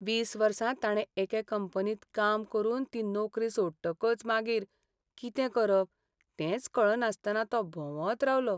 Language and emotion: Goan Konkani, sad